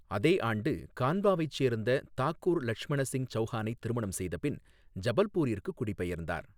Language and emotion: Tamil, neutral